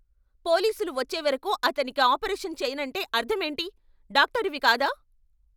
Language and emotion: Telugu, angry